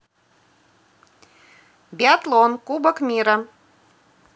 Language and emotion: Russian, positive